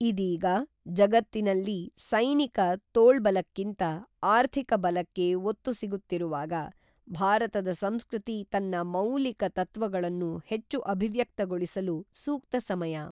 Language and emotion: Kannada, neutral